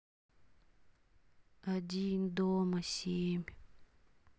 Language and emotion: Russian, sad